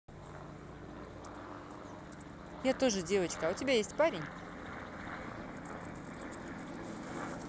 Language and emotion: Russian, neutral